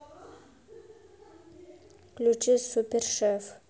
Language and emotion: Russian, neutral